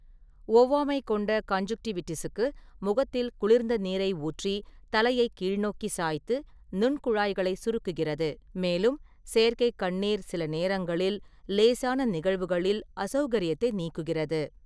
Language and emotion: Tamil, neutral